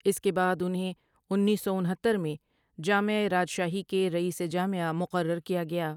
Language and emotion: Urdu, neutral